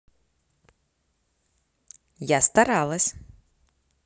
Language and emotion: Russian, positive